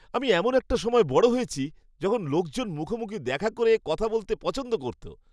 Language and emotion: Bengali, happy